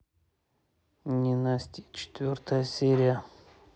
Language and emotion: Russian, neutral